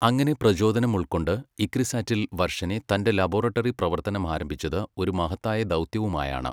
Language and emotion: Malayalam, neutral